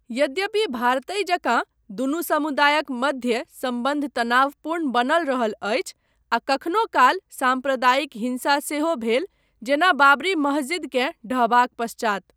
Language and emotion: Maithili, neutral